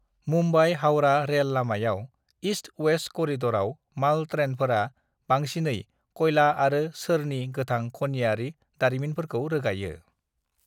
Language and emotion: Bodo, neutral